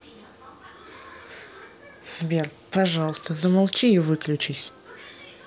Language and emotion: Russian, angry